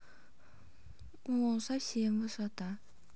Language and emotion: Russian, neutral